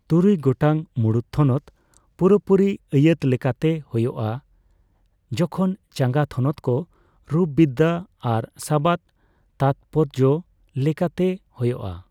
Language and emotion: Santali, neutral